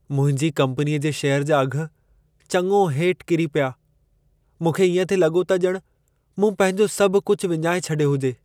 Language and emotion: Sindhi, sad